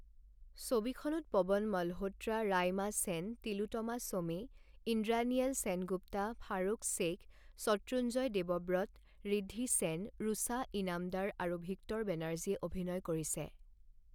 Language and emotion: Assamese, neutral